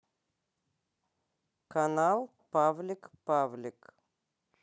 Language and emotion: Russian, neutral